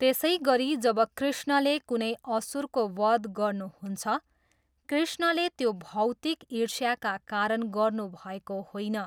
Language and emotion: Nepali, neutral